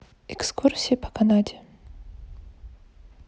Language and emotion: Russian, neutral